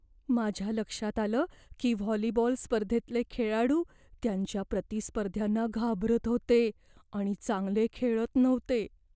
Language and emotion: Marathi, fearful